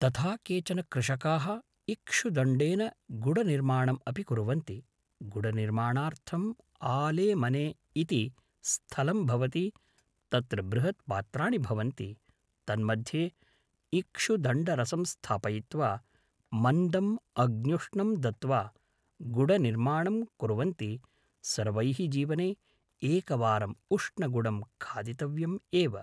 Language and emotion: Sanskrit, neutral